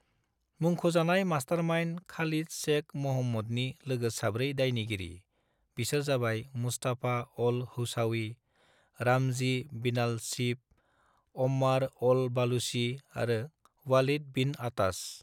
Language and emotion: Bodo, neutral